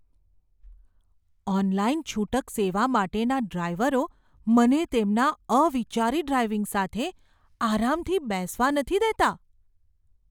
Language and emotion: Gujarati, fearful